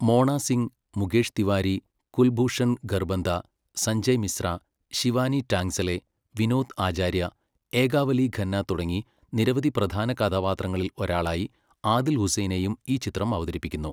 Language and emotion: Malayalam, neutral